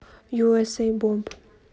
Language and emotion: Russian, neutral